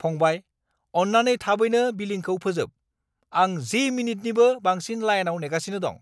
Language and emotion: Bodo, angry